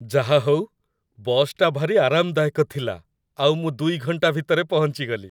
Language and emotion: Odia, happy